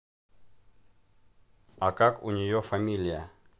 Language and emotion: Russian, neutral